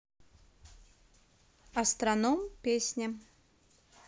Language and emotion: Russian, neutral